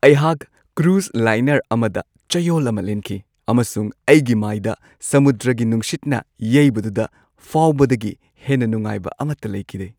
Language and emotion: Manipuri, happy